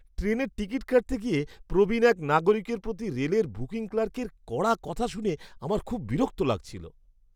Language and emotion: Bengali, disgusted